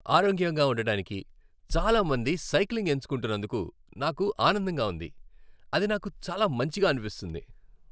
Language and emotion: Telugu, happy